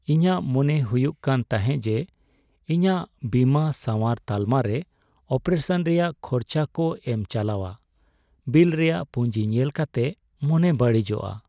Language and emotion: Santali, sad